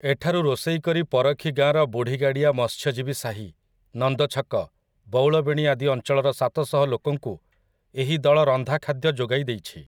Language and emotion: Odia, neutral